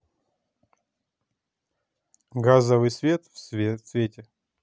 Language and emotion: Russian, neutral